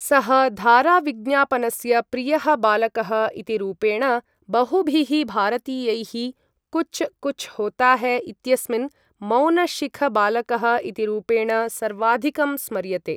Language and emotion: Sanskrit, neutral